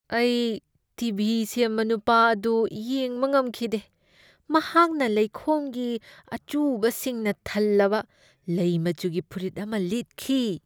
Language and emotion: Manipuri, disgusted